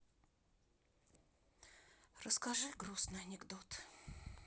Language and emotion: Russian, sad